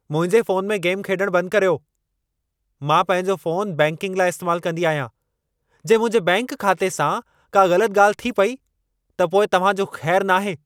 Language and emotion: Sindhi, angry